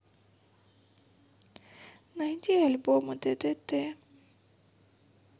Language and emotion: Russian, sad